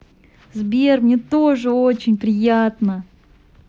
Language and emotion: Russian, positive